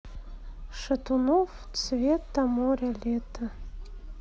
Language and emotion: Russian, neutral